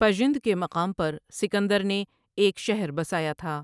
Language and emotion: Urdu, neutral